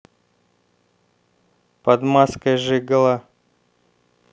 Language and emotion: Russian, neutral